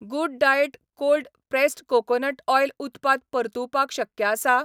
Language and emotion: Goan Konkani, neutral